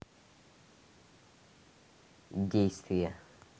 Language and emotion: Russian, neutral